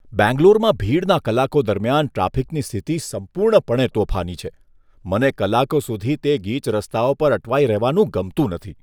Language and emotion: Gujarati, disgusted